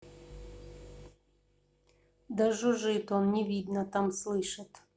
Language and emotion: Russian, neutral